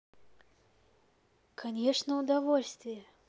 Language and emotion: Russian, positive